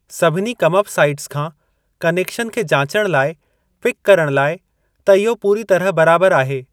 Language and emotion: Sindhi, neutral